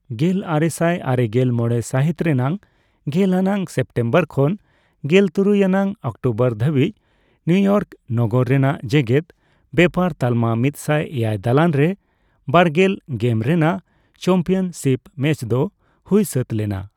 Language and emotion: Santali, neutral